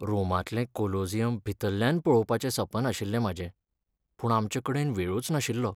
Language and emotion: Goan Konkani, sad